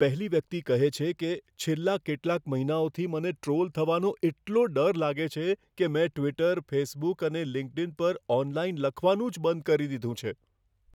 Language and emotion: Gujarati, fearful